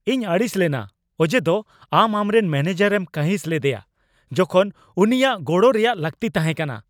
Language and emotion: Santali, angry